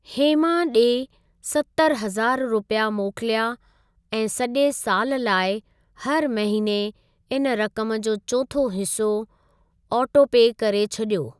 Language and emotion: Sindhi, neutral